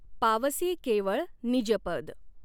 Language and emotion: Marathi, neutral